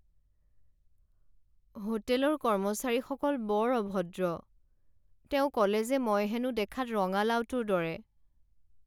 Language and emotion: Assamese, sad